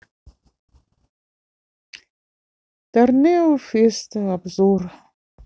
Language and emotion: Russian, sad